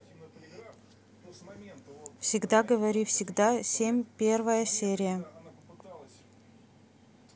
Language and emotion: Russian, neutral